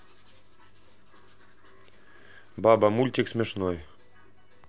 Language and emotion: Russian, neutral